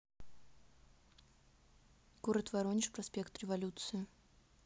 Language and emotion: Russian, neutral